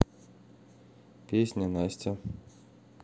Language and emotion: Russian, neutral